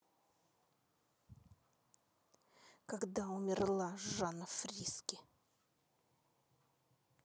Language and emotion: Russian, angry